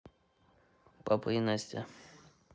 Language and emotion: Russian, neutral